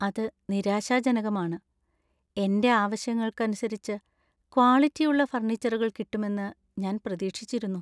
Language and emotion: Malayalam, sad